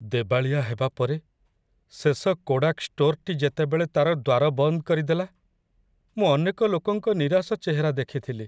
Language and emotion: Odia, sad